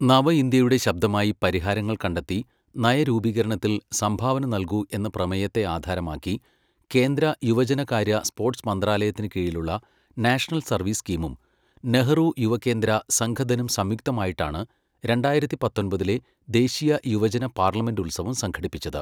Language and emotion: Malayalam, neutral